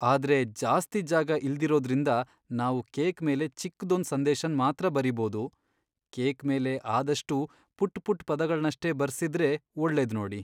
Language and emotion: Kannada, sad